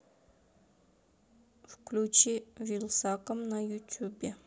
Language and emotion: Russian, neutral